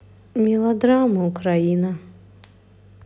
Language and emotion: Russian, sad